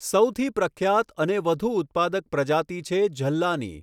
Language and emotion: Gujarati, neutral